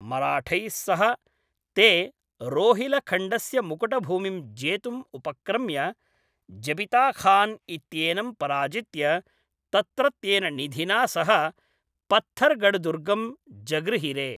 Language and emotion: Sanskrit, neutral